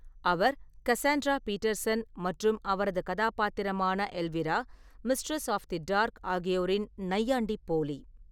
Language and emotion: Tamil, neutral